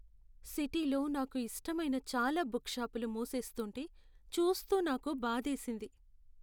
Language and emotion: Telugu, sad